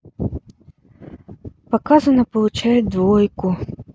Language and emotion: Russian, sad